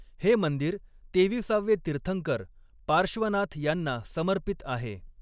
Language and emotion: Marathi, neutral